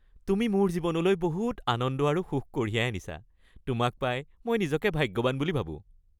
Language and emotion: Assamese, happy